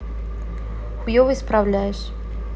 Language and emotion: Russian, neutral